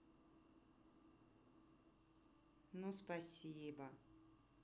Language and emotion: Russian, positive